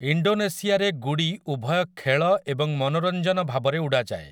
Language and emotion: Odia, neutral